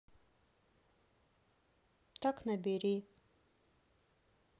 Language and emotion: Russian, sad